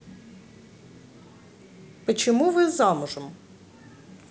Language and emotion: Russian, neutral